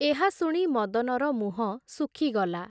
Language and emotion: Odia, neutral